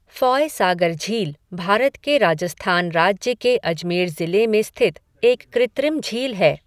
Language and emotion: Hindi, neutral